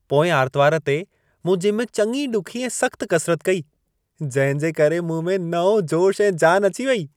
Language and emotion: Sindhi, happy